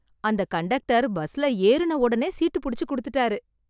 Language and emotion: Tamil, happy